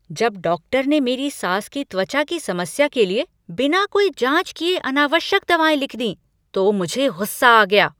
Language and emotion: Hindi, angry